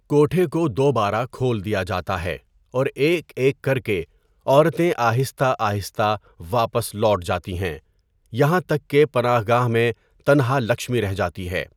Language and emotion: Urdu, neutral